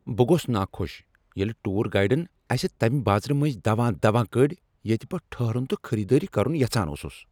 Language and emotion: Kashmiri, angry